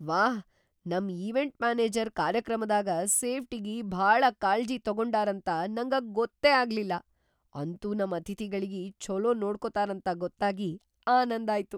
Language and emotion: Kannada, surprised